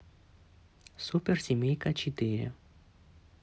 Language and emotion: Russian, neutral